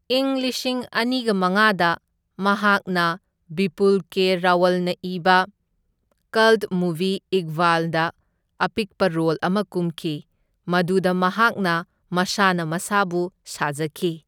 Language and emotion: Manipuri, neutral